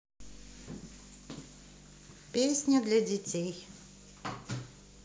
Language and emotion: Russian, neutral